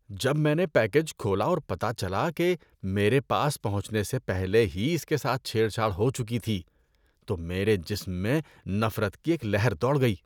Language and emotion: Urdu, disgusted